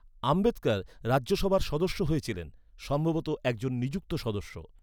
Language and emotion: Bengali, neutral